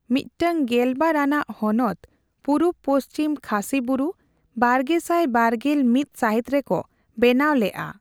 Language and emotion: Santali, neutral